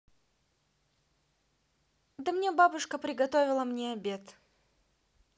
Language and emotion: Russian, positive